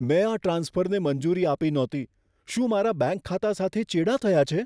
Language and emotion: Gujarati, fearful